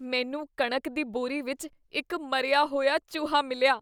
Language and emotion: Punjabi, disgusted